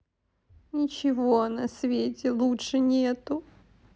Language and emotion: Russian, sad